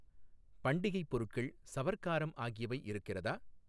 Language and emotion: Tamil, neutral